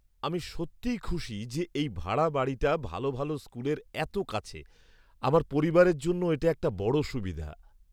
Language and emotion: Bengali, surprised